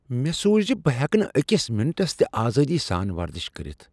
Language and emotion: Kashmiri, surprised